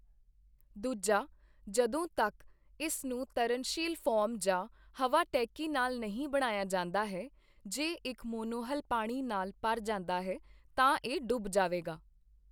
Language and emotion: Punjabi, neutral